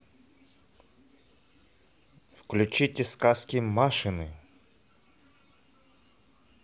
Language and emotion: Russian, positive